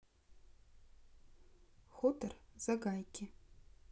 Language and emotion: Russian, neutral